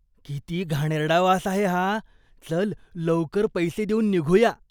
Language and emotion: Marathi, disgusted